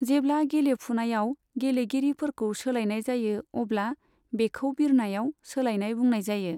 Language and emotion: Bodo, neutral